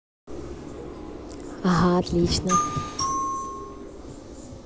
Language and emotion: Russian, positive